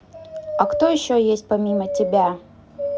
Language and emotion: Russian, neutral